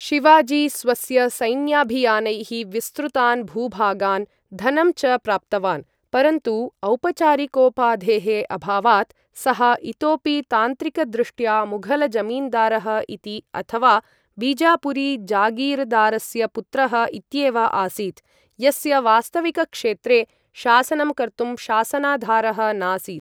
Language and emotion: Sanskrit, neutral